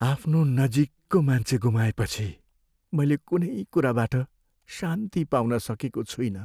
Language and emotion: Nepali, sad